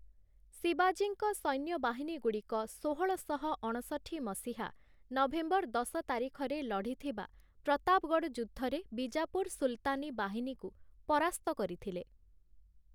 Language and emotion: Odia, neutral